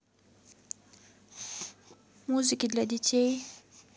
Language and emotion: Russian, neutral